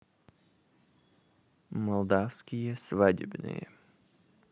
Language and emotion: Russian, neutral